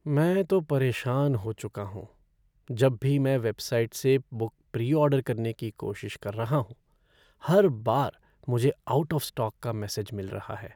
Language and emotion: Hindi, sad